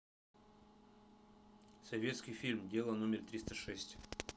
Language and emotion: Russian, neutral